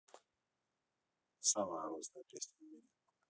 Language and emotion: Russian, neutral